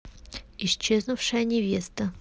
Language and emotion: Russian, neutral